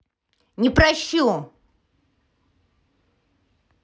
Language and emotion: Russian, angry